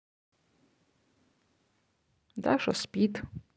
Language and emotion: Russian, neutral